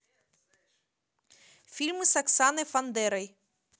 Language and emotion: Russian, neutral